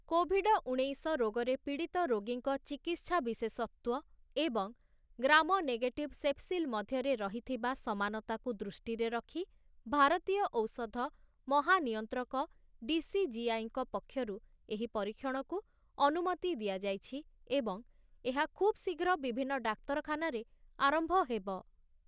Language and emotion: Odia, neutral